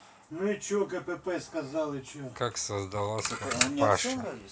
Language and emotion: Russian, neutral